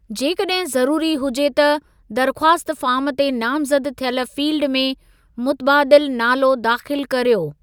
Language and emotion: Sindhi, neutral